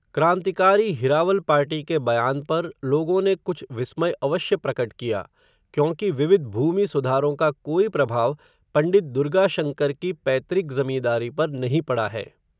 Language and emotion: Hindi, neutral